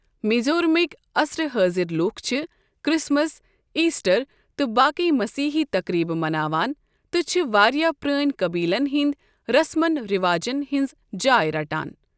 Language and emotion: Kashmiri, neutral